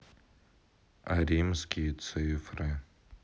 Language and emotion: Russian, sad